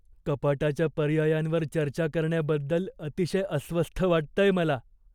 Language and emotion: Marathi, fearful